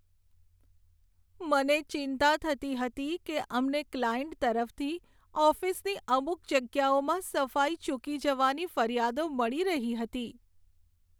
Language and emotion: Gujarati, sad